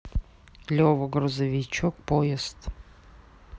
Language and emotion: Russian, neutral